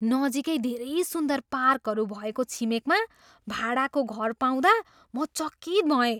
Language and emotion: Nepali, surprised